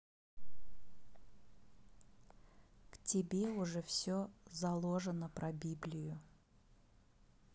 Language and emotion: Russian, neutral